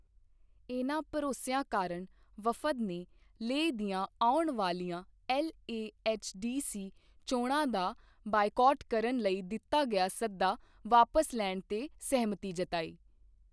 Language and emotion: Punjabi, neutral